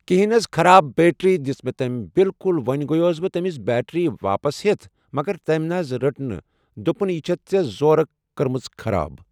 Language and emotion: Kashmiri, neutral